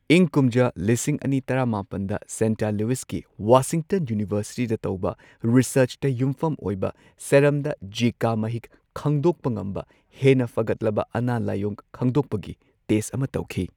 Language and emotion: Manipuri, neutral